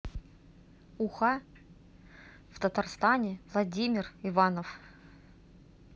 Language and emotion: Russian, neutral